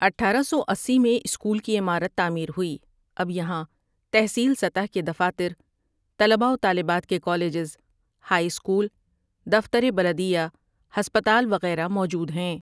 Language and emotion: Urdu, neutral